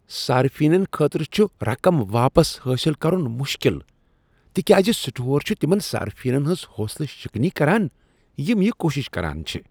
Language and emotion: Kashmiri, disgusted